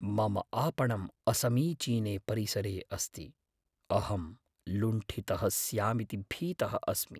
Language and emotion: Sanskrit, fearful